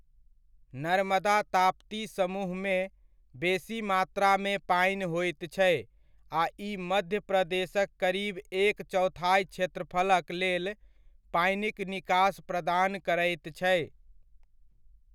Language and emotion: Maithili, neutral